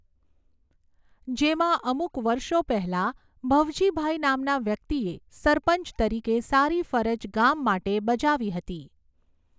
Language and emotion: Gujarati, neutral